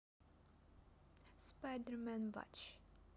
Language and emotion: Russian, neutral